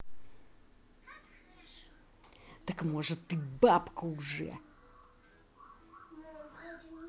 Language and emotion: Russian, angry